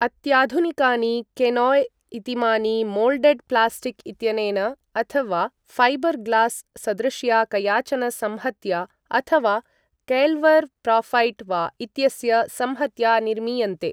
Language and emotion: Sanskrit, neutral